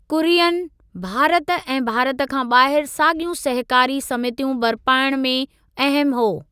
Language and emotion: Sindhi, neutral